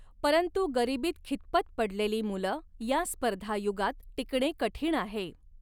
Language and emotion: Marathi, neutral